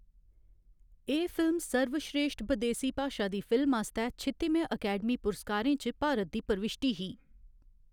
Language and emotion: Dogri, neutral